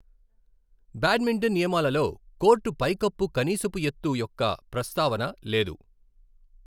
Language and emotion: Telugu, neutral